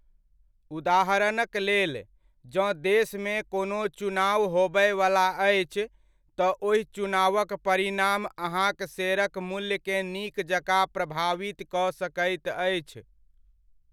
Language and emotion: Maithili, neutral